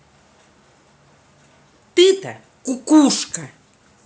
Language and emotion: Russian, angry